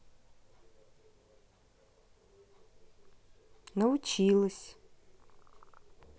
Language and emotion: Russian, neutral